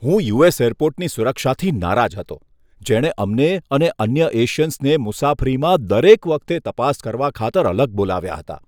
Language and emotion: Gujarati, disgusted